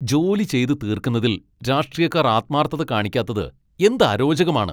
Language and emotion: Malayalam, angry